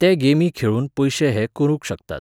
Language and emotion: Goan Konkani, neutral